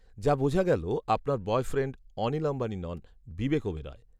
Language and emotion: Bengali, neutral